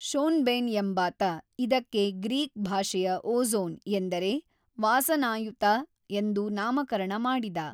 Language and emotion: Kannada, neutral